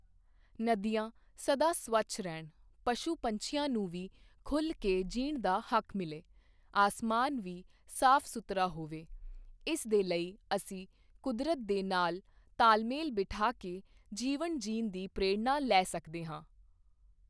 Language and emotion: Punjabi, neutral